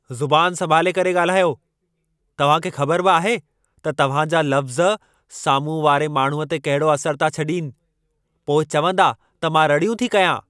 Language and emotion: Sindhi, angry